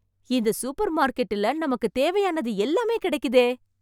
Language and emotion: Tamil, surprised